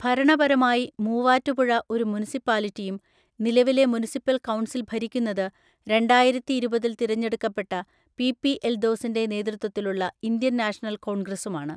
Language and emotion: Malayalam, neutral